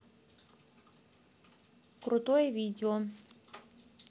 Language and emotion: Russian, neutral